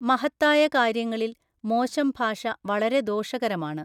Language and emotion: Malayalam, neutral